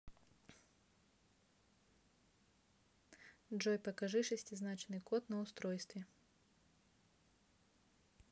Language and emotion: Russian, neutral